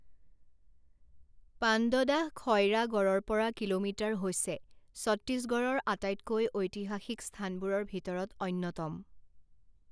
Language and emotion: Assamese, neutral